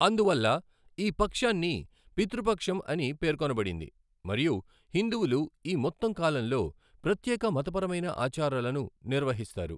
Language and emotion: Telugu, neutral